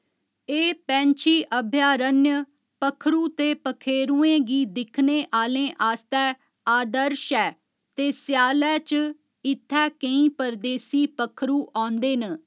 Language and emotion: Dogri, neutral